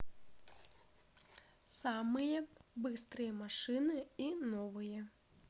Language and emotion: Russian, neutral